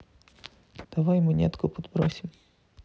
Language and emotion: Russian, neutral